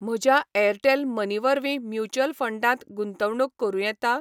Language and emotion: Goan Konkani, neutral